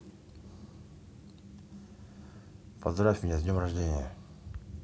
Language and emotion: Russian, neutral